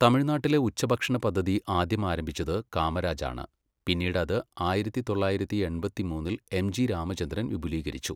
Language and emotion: Malayalam, neutral